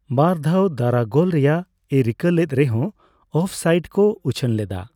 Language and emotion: Santali, neutral